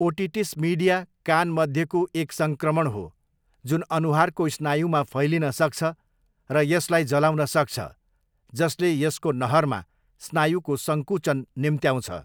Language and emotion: Nepali, neutral